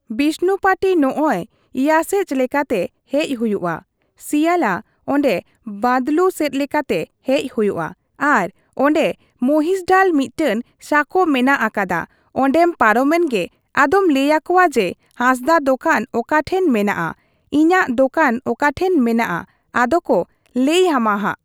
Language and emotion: Santali, neutral